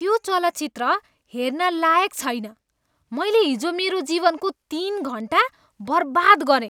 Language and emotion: Nepali, disgusted